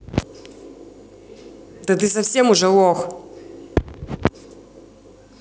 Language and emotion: Russian, angry